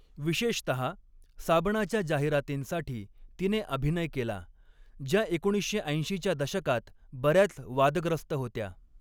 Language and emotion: Marathi, neutral